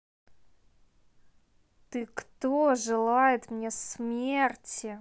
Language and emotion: Russian, neutral